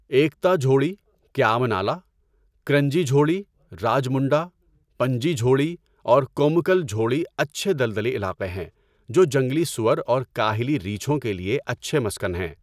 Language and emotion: Urdu, neutral